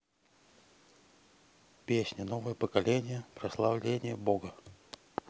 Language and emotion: Russian, neutral